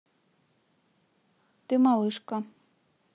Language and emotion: Russian, neutral